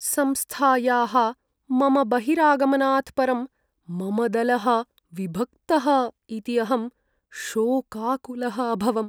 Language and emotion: Sanskrit, sad